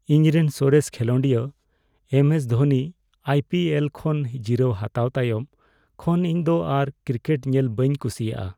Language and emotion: Santali, sad